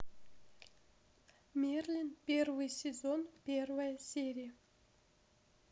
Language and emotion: Russian, neutral